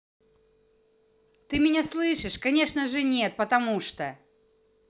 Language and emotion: Russian, angry